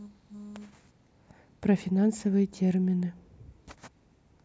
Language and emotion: Russian, neutral